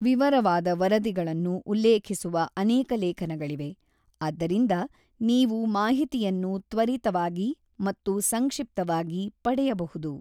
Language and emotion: Kannada, neutral